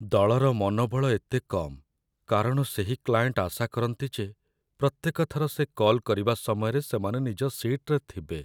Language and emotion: Odia, sad